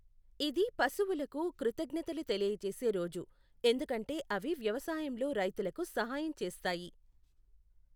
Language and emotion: Telugu, neutral